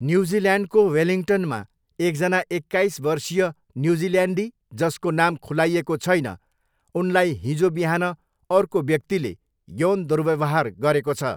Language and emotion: Nepali, neutral